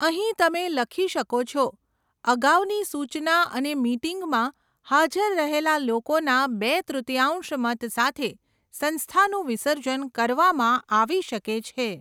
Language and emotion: Gujarati, neutral